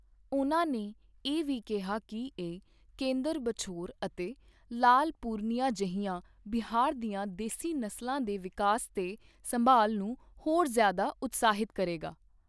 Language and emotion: Punjabi, neutral